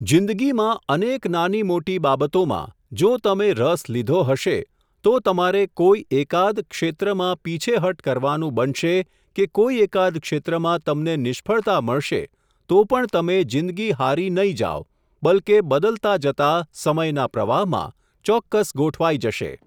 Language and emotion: Gujarati, neutral